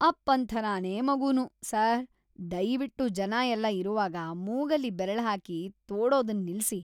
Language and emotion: Kannada, disgusted